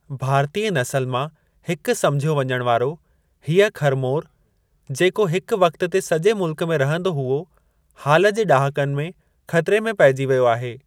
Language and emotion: Sindhi, neutral